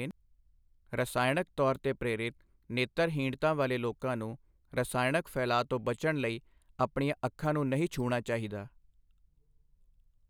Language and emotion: Punjabi, neutral